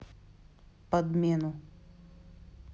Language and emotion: Russian, neutral